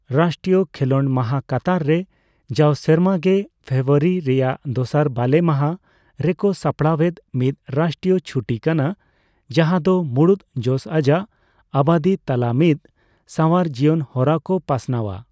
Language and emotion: Santali, neutral